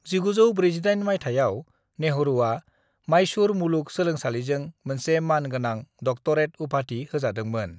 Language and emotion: Bodo, neutral